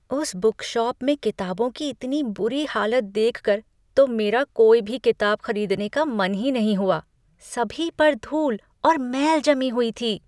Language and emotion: Hindi, disgusted